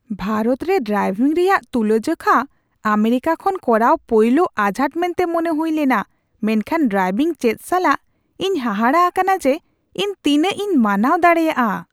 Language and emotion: Santali, surprised